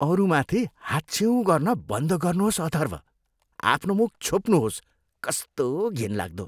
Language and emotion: Nepali, disgusted